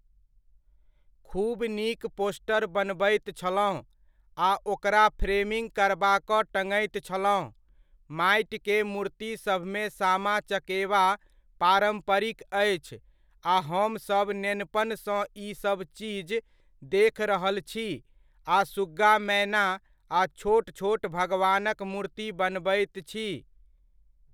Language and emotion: Maithili, neutral